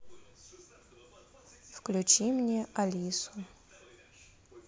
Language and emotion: Russian, neutral